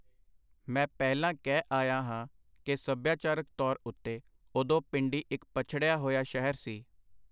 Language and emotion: Punjabi, neutral